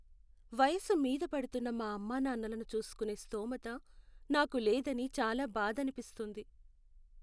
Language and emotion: Telugu, sad